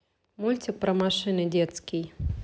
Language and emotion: Russian, neutral